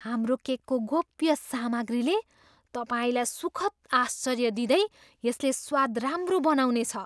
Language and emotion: Nepali, surprised